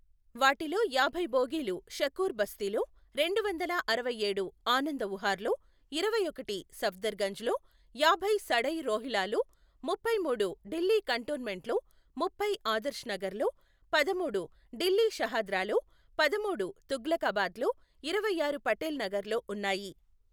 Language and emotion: Telugu, neutral